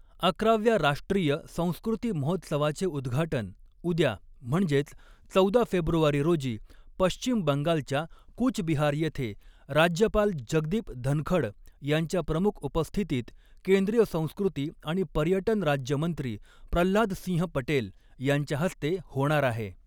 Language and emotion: Marathi, neutral